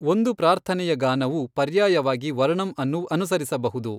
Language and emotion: Kannada, neutral